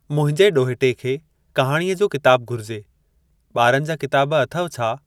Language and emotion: Sindhi, neutral